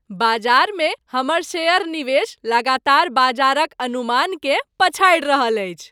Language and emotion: Maithili, happy